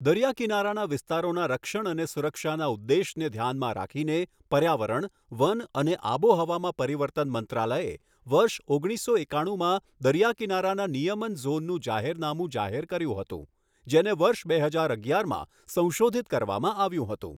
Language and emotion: Gujarati, neutral